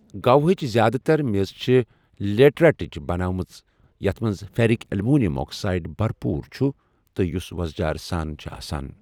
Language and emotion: Kashmiri, neutral